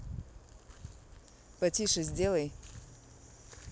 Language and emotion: Russian, neutral